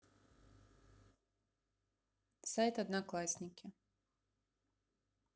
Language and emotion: Russian, neutral